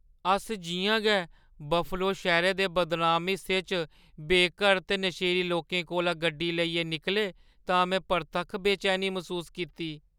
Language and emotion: Dogri, fearful